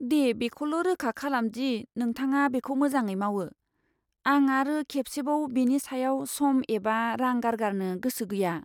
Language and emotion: Bodo, fearful